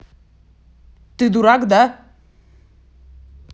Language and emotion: Russian, angry